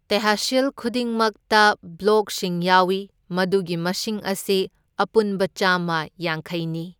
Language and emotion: Manipuri, neutral